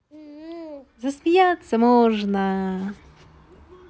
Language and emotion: Russian, positive